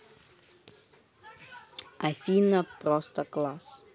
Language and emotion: Russian, neutral